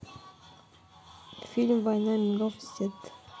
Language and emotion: Russian, neutral